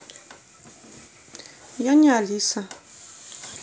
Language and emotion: Russian, neutral